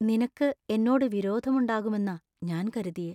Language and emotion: Malayalam, fearful